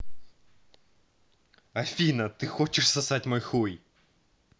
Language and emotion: Russian, angry